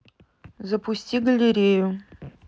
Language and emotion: Russian, neutral